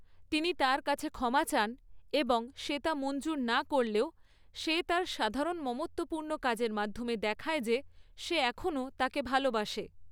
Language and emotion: Bengali, neutral